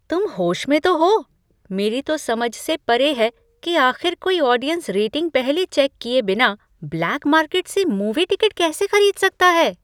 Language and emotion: Hindi, surprised